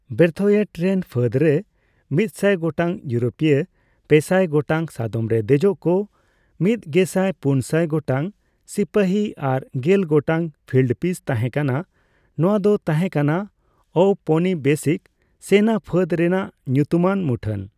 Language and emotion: Santali, neutral